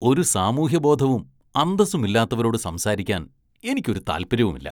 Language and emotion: Malayalam, disgusted